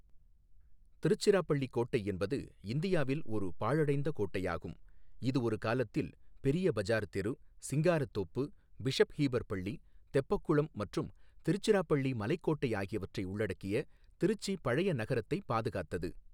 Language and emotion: Tamil, neutral